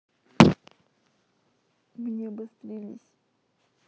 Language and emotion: Russian, sad